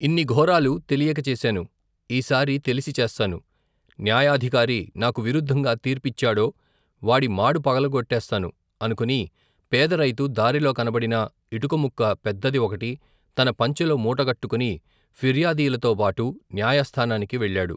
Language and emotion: Telugu, neutral